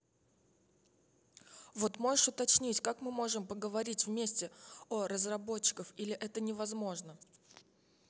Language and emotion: Russian, neutral